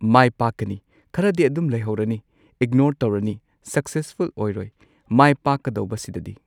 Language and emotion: Manipuri, neutral